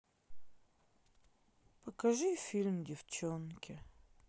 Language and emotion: Russian, sad